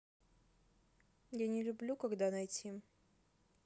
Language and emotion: Russian, neutral